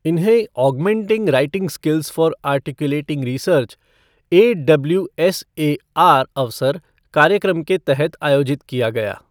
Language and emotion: Hindi, neutral